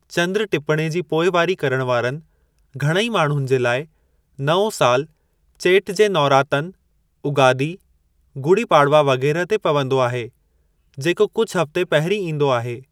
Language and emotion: Sindhi, neutral